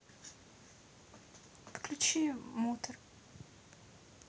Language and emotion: Russian, sad